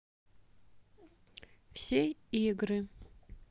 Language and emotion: Russian, neutral